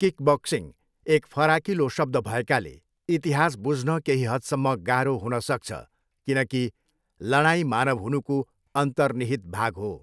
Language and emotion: Nepali, neutral